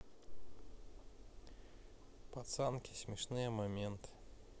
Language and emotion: Russian, neutral